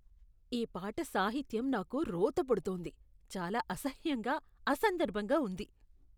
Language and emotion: Telugu, disgusted